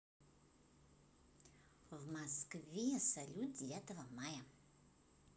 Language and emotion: Russian, positive